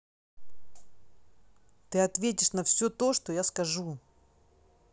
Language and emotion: Russian, angry